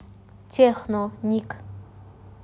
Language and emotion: Russian, neutral